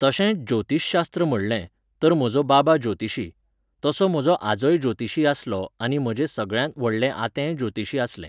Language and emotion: Goan Konkani, neutral